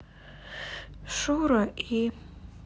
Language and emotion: Russian, sad